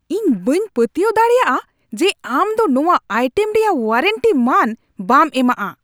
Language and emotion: Santali, angry